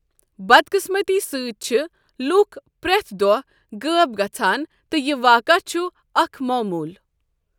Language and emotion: Kashmiri, neutral